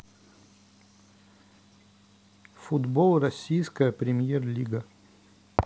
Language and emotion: Russian, neutral